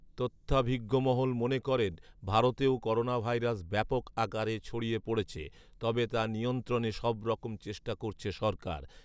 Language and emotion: Bengali, neutral